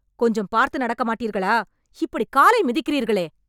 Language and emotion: Tamil, angry